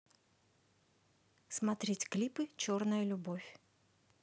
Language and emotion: Russian, neutral